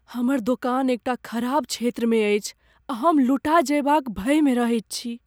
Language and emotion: Maithili, fearful